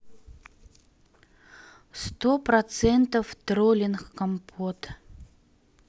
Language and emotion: Russian, neutral